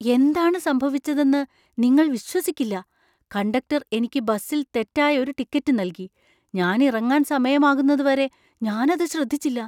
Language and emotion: Malayalam, surprised